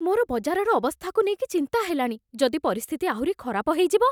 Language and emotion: Odia, fearful